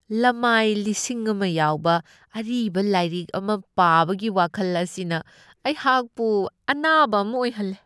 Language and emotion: Manipuri, disgusted